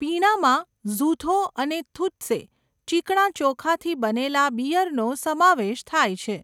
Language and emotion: Gujarati, neutral